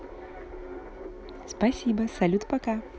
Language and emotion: Russian, positive